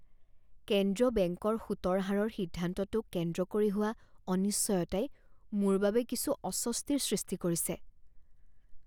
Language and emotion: Assamese, fearful